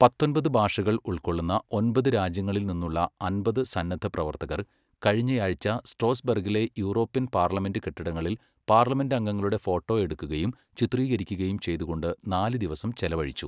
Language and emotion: Malayalam, neutral